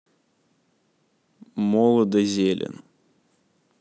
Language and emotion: Russian, neutral